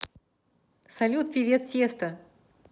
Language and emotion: Russian, positive